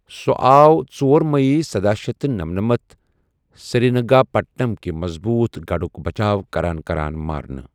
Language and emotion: Kashmiri, neutral